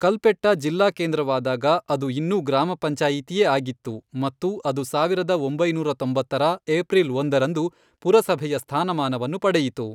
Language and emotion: Kannada, neutral